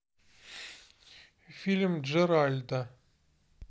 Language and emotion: Russian, neutral